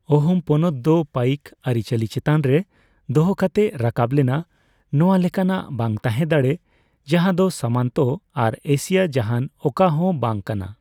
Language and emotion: Santali, neutral